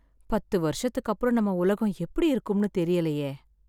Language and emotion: Tamil, sad